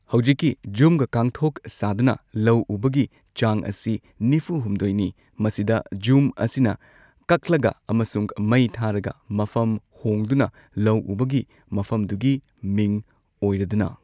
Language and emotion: Manipuri, neutral